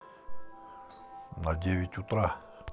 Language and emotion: Russian, neutral